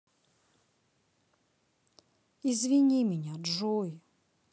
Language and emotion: Russian, sad